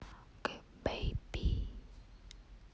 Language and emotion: Russian, neutral